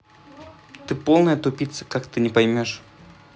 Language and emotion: Russian, angry